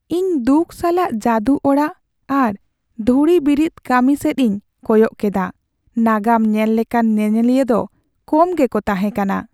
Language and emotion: Santali, sad